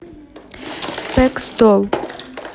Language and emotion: Russian, neutral